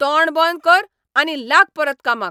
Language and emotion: Goan Konkani, angry